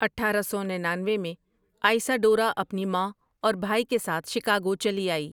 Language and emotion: Urdu, neutral